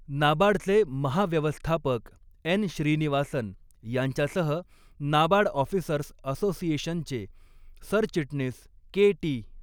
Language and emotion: Marathi, neutral